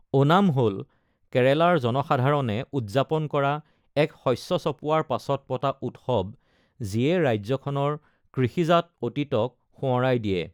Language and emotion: Assamese, neutral